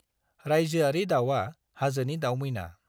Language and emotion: Bodo, neutral